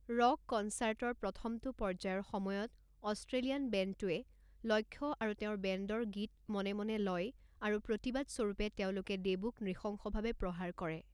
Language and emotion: Assamese, neutral